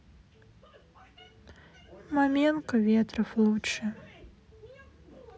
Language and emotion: Russian, sad